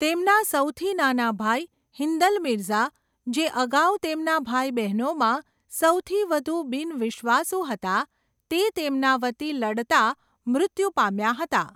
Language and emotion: Gujarati, neutral